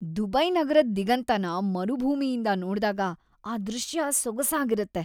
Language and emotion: Kannada, happy